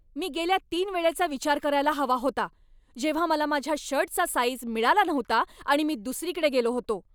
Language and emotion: Marathi, angry